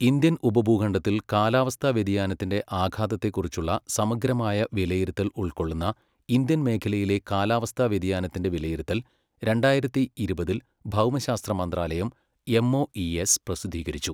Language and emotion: Malayalam, neutral